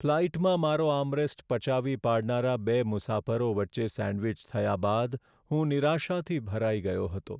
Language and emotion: Gujarati, sad